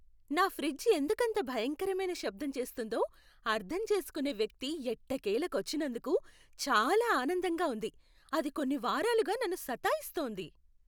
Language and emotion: Telugu, happy